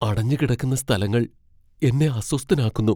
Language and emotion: Malayalam, fearful